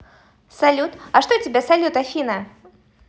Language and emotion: Russian, positive